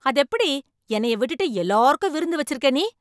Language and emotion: Tamil, angry